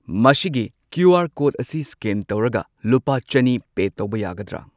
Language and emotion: Manipuri, neutral